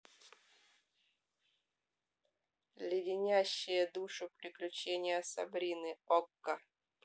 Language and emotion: Russian, neutral